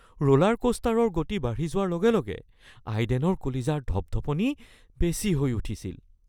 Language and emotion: Assamese, fearful